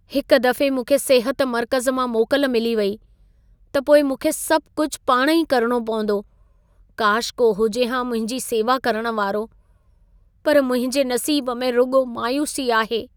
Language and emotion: Sindhi, sad